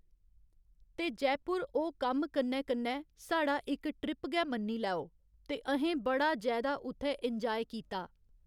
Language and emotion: Dogri, neutral